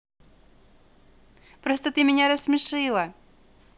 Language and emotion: Russian, positive